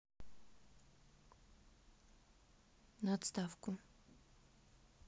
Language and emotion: Russian, neutral